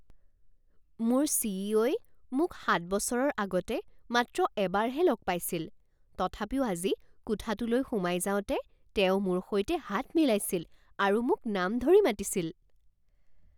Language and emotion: Assamese, surprised